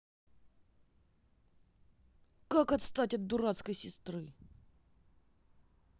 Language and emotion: Russian, angry